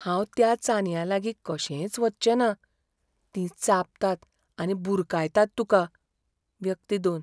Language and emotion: Goan Konkani, fearful